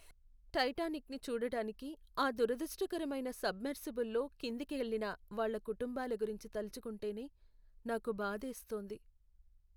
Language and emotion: Telugu, sad